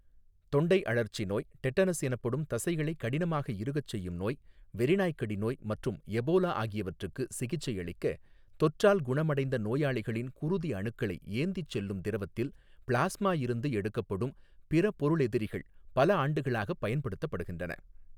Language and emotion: Tamil, neutral